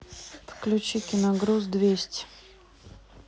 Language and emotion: Russian, neutral